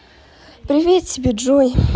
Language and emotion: Russian, positive